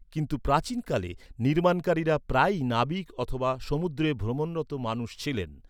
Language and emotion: Bengali, neutral